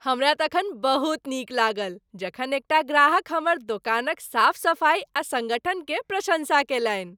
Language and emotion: Maithili, happy